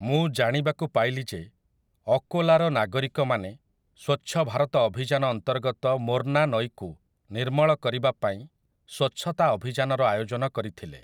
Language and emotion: Odia, neutral